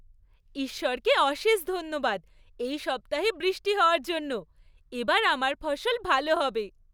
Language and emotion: Bengali, happy